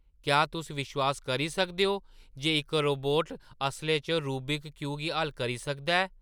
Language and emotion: Dogri, surprised